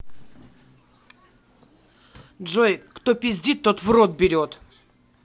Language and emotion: Russian, angry